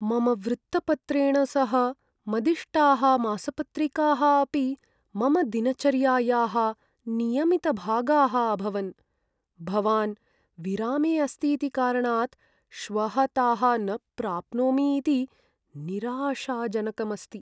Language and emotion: Sanskrit, sad